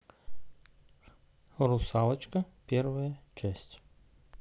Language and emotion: Russian, neutral